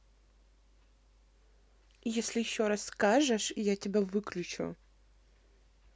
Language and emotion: Russian, neutral